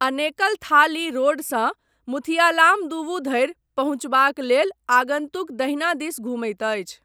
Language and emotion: Maithili, neutral